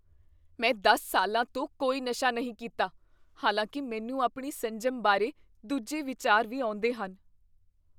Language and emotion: Punjabi, fearful